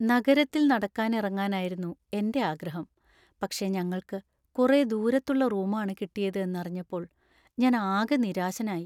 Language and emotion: Malayalam, sad